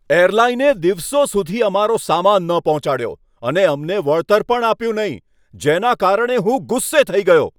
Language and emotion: Gujarati, angry